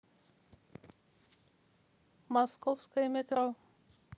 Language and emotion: Russian, neutral